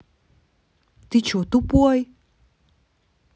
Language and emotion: Russian, angry